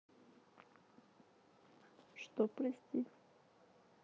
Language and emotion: Russian, neutral